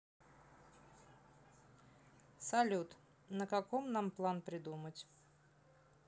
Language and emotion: Russian, neutral